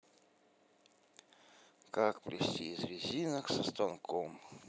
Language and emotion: Russian, sad